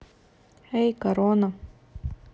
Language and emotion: Russian, neutral